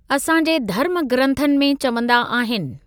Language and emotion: Sindhi, neutral